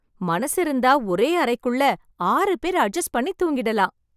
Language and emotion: Tamil, happy